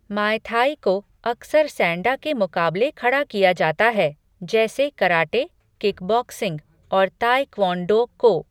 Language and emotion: Hindi, neutral